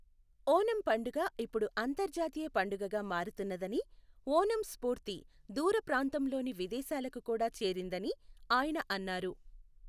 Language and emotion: Telugu, neutral